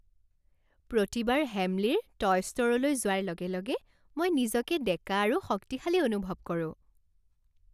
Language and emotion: Assamese, happy